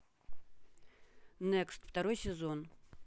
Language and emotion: Russian, neutral